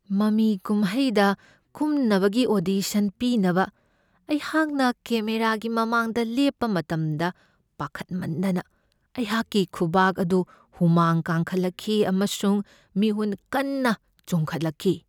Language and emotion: Manipuri, fearful